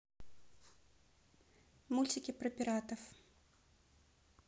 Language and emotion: Russian, neutral